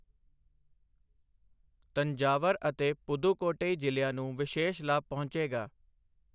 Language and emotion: Punjabi, neutral